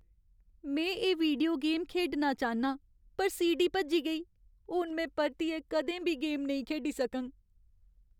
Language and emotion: Dogri, sad